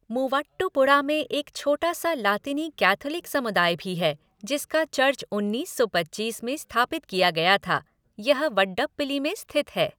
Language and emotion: Hindi, neutral